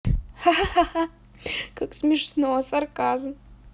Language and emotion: Russian, positive